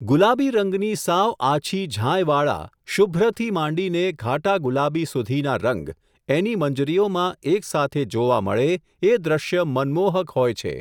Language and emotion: Gujarati, neutral